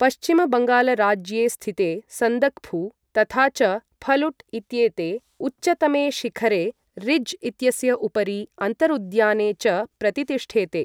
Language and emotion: Sanskrit, neutral